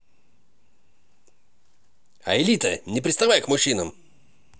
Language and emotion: Russian, positive